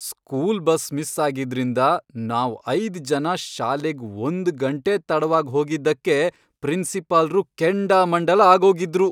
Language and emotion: Kannada, angry